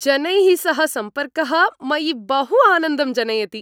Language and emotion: Sanskrit, happy